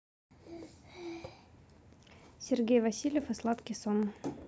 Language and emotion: Russian, neutral